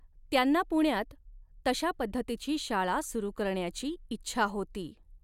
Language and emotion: Marathi, neutral